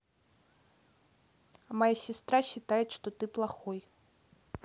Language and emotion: Russian, neutral